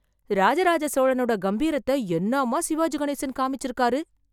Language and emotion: Tamil, surprised